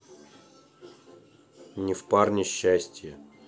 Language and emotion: Russian, neutral